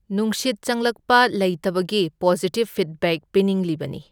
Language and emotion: Manipuri, neutral